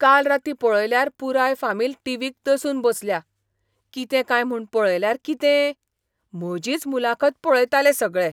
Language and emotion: Goan Konkani, surprised